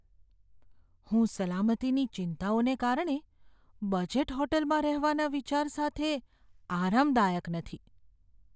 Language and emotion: Gujarati, fearful